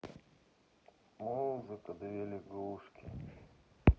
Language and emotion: Russian, sad